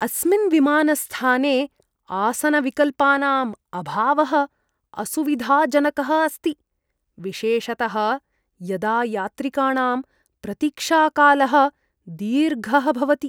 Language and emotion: Sanskrit, disgusted